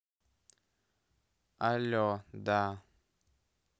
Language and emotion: Russian, neutral